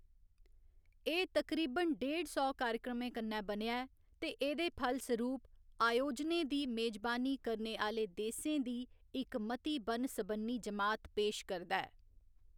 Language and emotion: Dogri, neutral